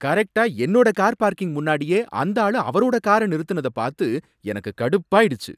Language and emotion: Tamil, angry